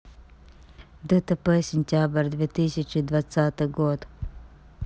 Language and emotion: Russian, neutral